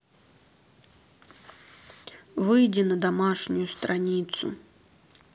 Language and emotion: Russian, neutral